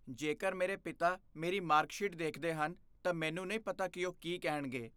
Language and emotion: Punjabi, fearful